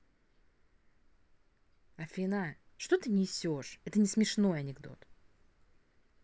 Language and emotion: Russian, angry